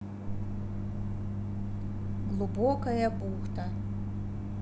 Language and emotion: Russian, neutral